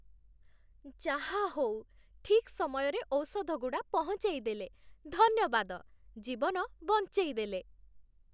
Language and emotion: Odia, happy